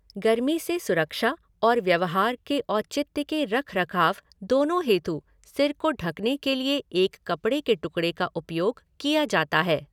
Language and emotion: Hindi, neutral